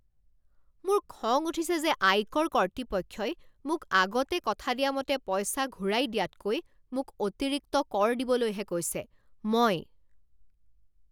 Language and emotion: Assamese, angry